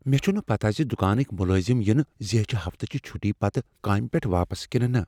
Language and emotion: Kashmiri, fearful